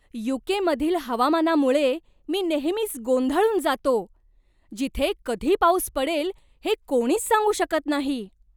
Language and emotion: Marathi, surprised